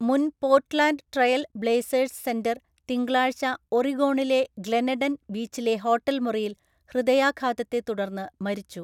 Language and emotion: Malayalam, neutral